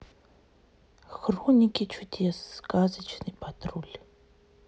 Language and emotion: Russian, neutral